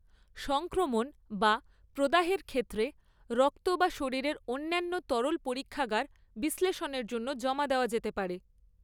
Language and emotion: Bengali, neutral